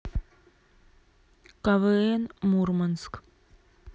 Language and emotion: Russian, neutral